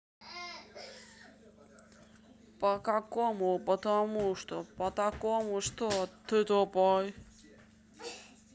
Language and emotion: Russian, neutral